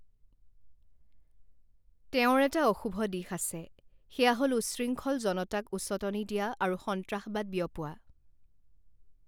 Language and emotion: Assamese, neutral